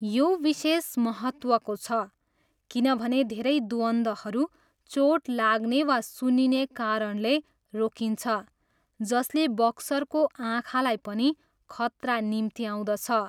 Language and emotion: Nepali, neutral